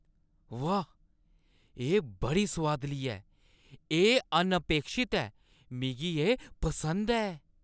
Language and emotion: Dogri, surprised